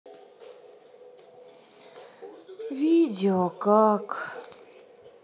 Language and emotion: Russian, sad